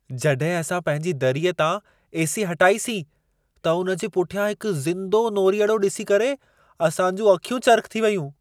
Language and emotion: Sindhi, surprised